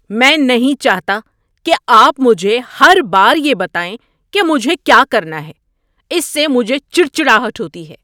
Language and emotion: Urdu, angry